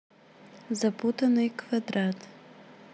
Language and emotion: Russian, neutral